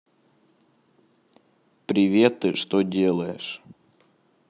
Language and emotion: Russian, neutral